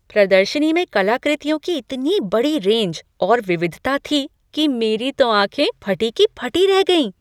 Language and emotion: Hindi, surprised